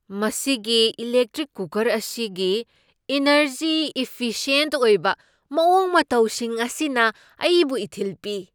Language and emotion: Manipuri, surprised